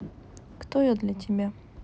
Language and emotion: Russian, sad